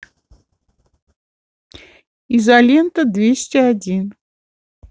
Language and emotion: Russian, neutral